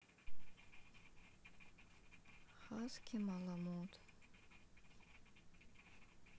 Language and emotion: Russian, sad